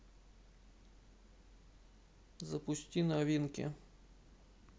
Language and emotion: Russian, neutral